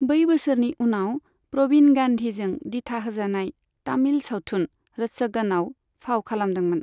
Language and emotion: Bodo, neutral